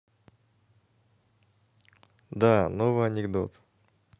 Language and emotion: Russian, neutral